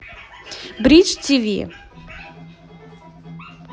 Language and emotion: Russian, positive